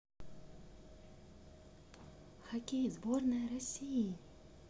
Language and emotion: Russian, neutral